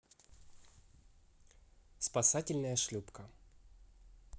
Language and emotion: Russian, neutral